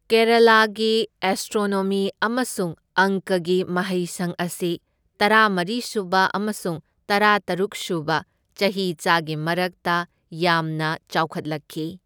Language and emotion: Manipuri, neutral